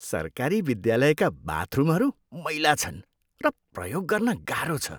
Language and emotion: Nepali, disgusted